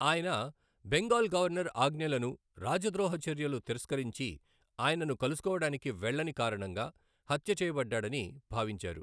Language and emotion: Telugu, neutral